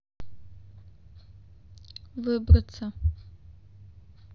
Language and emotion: Russian, neutral